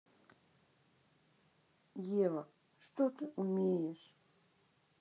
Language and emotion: Russian, neutral